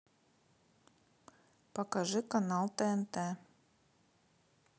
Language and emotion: Russian, neutral